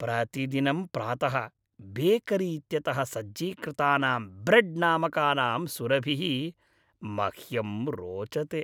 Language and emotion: Sanskrit, happy